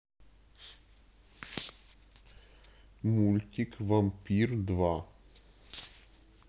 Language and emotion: Russian, neutral